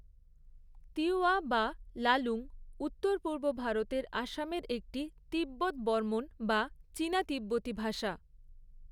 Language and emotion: Bengali, neutral